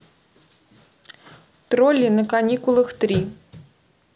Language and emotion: Russian, neutral